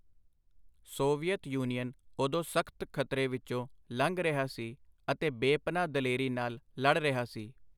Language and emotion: Punjabi, neutral